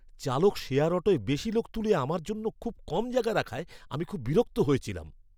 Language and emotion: Bengali, angry